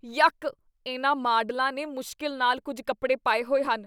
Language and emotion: Punjabi, disgusted